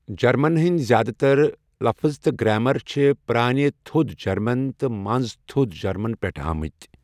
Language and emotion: Kashmiri, neutral